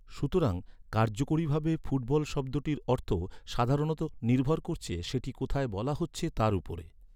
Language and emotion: Bengali, neutral